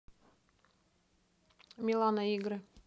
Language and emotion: Russian, neutral